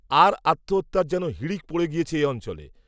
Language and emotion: Bengali, neutral